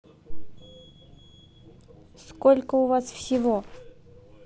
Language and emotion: Russian, neutral